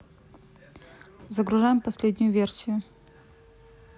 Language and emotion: Russian, neutral